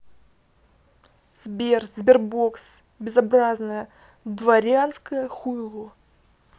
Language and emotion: Russian, angry